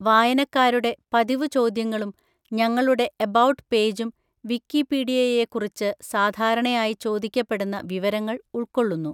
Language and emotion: Malayalam, neutral